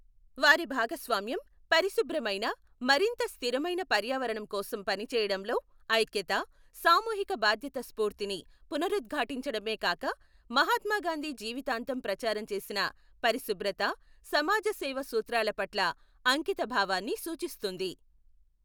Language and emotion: Telugu, neutral